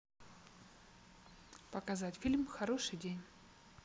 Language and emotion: Russian, neutral